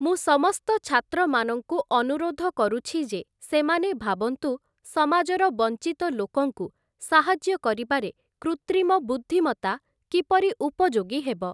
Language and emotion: Odia, neutral